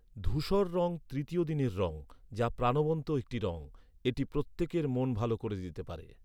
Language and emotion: Bengali, neutral